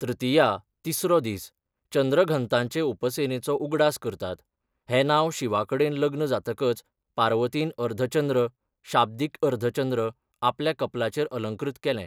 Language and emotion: Goan Konkani, neutral